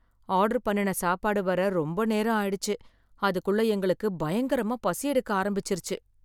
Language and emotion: Tamil, sad